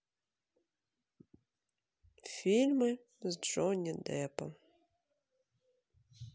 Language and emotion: Russian, sad